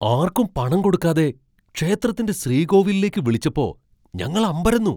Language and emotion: Malayalam, surprised